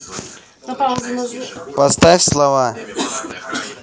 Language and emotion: Russian, neutral